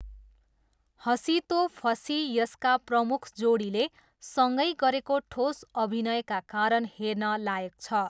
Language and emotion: Nepali, neutral